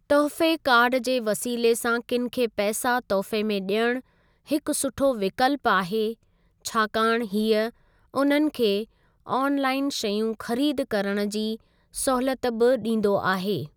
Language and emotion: Sindhi, neutral